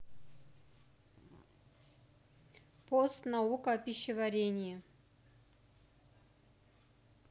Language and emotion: Russian, neutral